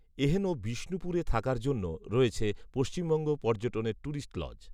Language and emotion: Bengali, neutral